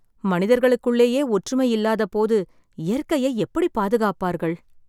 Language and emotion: Tamil, sad